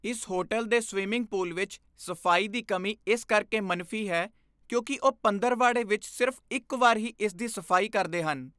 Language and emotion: Punjabi, disgusted